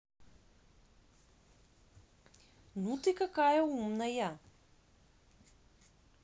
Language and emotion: Russian, positive